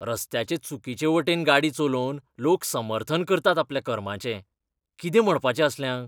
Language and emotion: Goan Konkani, disgusted